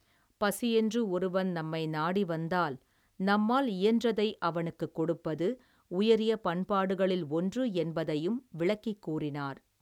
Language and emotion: Tamil, neutral